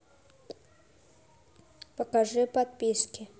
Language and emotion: Russian, neutral